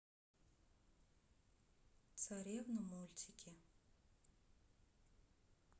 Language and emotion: Russian, sad